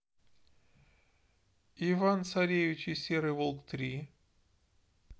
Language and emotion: Russian, neutral